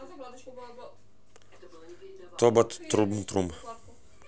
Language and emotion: Russian, neutral